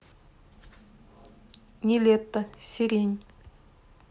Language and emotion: Russian, neutral